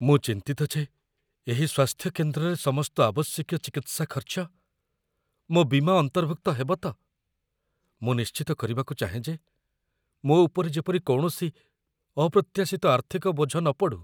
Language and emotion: Odia, fearful